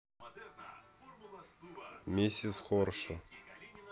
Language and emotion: Russian, neutral